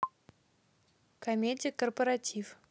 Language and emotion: Russian, neutral